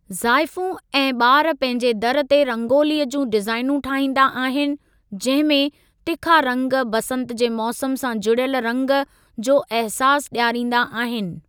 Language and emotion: Sindhi, neutral